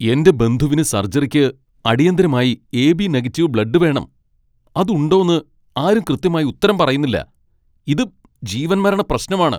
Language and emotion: Malayalam, angry